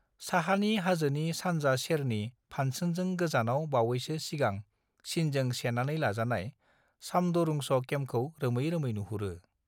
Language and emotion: Bodo, neutral